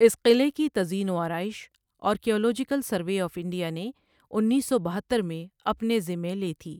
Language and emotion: Urdu, neutral